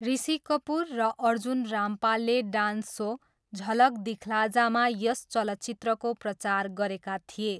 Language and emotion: Nepali, neutral